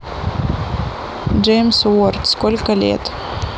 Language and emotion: Russian, neutral